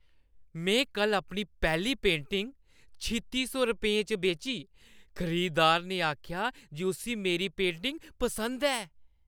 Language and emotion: Dogri, happy